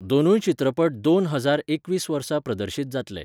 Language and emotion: Goan Konkani, neutral